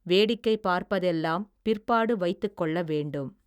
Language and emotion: Tamil, neutral